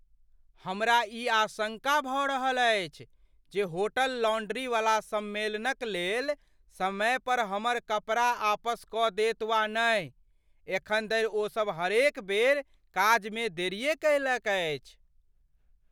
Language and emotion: Maithili, fearful